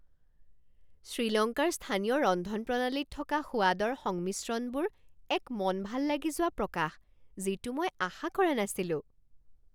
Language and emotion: Assamese, surprised